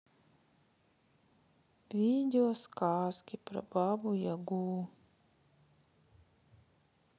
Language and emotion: Russian, sad